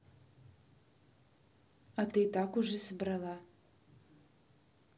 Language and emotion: Russian, neutral